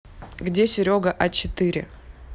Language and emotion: Russian, neutral